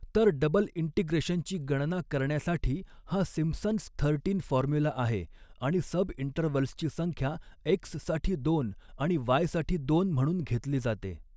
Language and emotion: Marathi, neutral